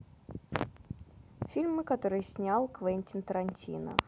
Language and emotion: Russian, neutral